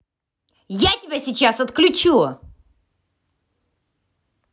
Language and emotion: Russian, angry